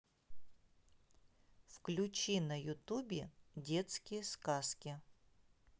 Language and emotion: Russian, neutral